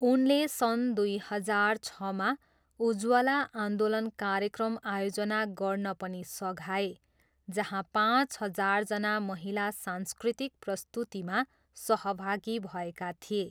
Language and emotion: Nepali, neutral